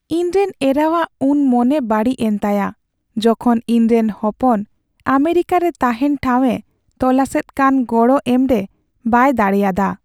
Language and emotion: Santali, sad